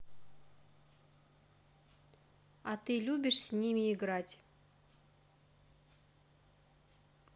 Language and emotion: Russian, neutral